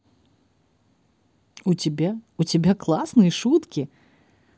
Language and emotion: Russian, positive